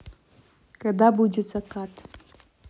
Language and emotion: Russian, neutral